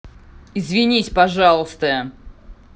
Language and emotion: Russian, angry